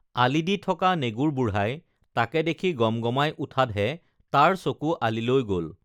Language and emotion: Assamese, neutral